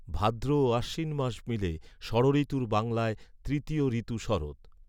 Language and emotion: Bengali, neutral